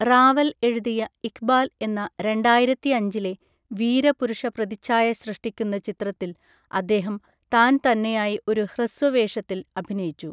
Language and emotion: Malayalam, neutral